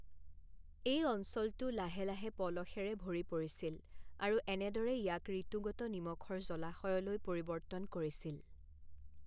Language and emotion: Assamese, neutral